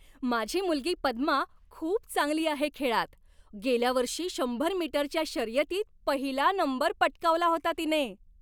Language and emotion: Marathi, happy